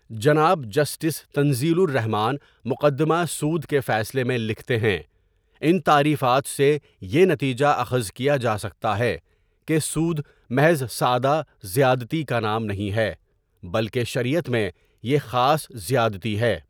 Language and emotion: Urdu, neutral